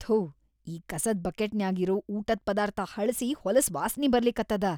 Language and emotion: Kannada, disgusted